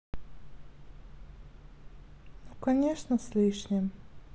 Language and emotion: Russian, sad